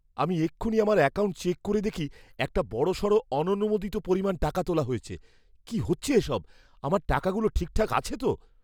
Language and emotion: Bengali, fearful